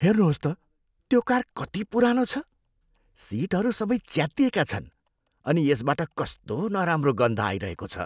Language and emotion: Nepali, disgusted